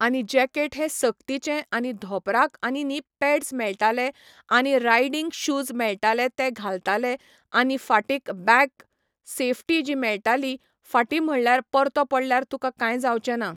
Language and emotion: Goan Konkani, neutral